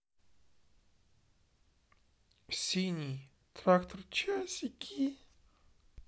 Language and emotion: Russian, sad